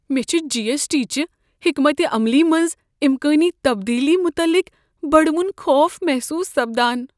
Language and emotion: Kashmiri, fearful